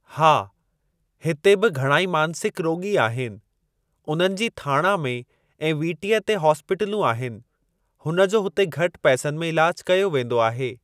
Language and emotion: Sindhi, neutral